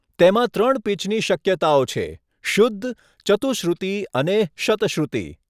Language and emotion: Gujarati, neutral